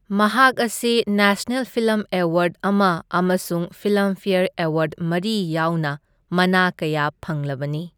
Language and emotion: Manipuri, neutral